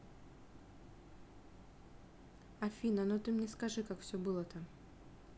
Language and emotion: Russian, neutral